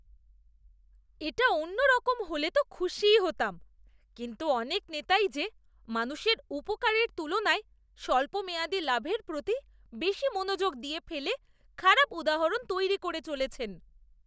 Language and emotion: Bengali, disgusted